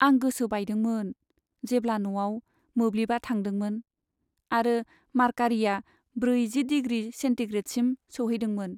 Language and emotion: Bodo, sad